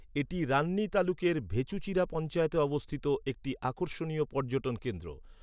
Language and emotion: Bengali, neutral